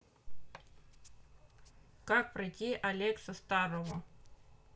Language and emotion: Russian, neutral